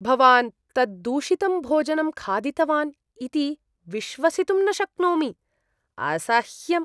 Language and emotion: Sanskrit, disgusted